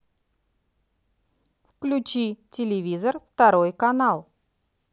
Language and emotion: Russian, neutral